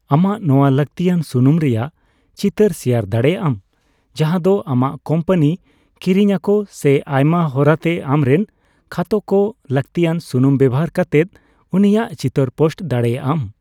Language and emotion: Santali, neutral